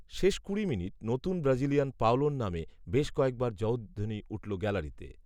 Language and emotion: Bengali, neutral